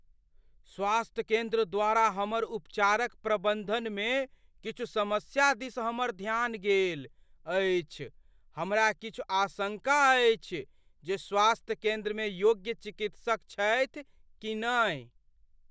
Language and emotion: Maithili, fearful